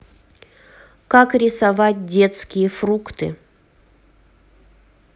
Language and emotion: Russian, neutral